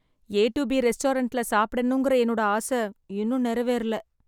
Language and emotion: Tamil, sad